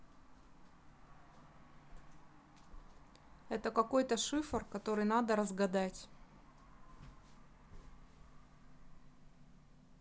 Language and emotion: Russian, neutral